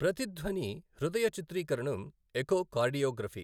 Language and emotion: Telugu, neutral